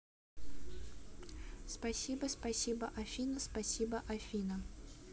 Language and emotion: Russian, neutral